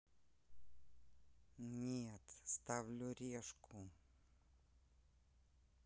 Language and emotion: Russian, neutral